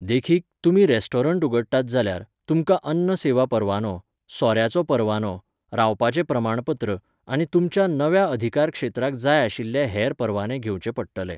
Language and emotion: Goan Konkani, neutral